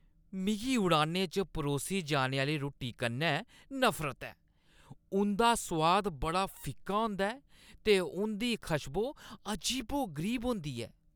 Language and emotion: Dogri, disgusted